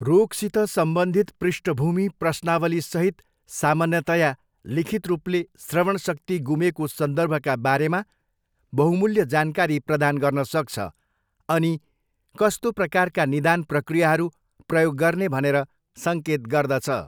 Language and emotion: Nepali, neutral